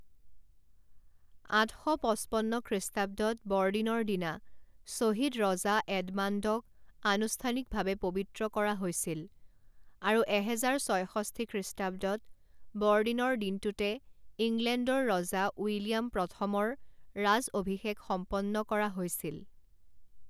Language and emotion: Assamese, neutral